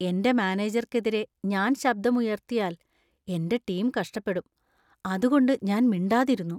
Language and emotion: Malayalam, fearful